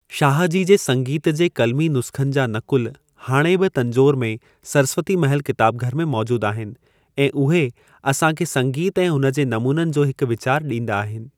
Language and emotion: Sindhi, neutral